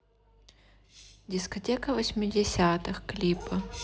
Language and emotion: Russian, neutral